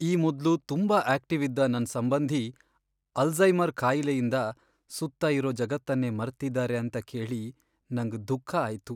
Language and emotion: Kannada, sad